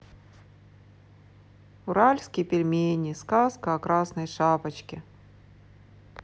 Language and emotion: Russian, sad